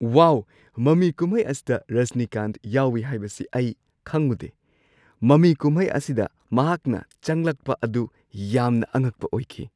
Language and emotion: Manipuri, surprised